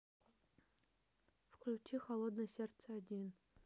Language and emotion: Russian, neutral